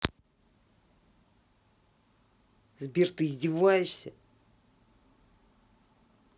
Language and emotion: Russian, angry